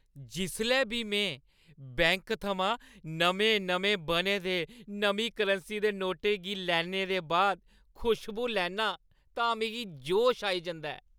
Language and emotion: Dogri, happy